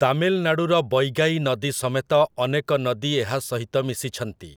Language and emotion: Odia, neutral